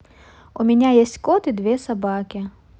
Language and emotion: Russian, neutral